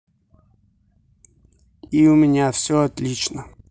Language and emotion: Russian, neutral